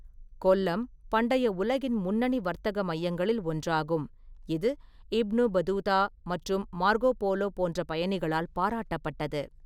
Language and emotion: Tamil, neutral